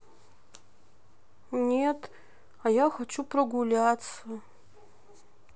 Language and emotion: Russian, sad